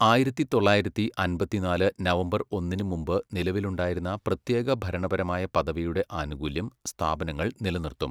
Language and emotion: Malayalam, neutral